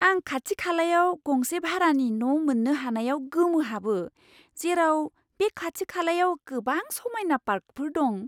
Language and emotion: Bodo, surprised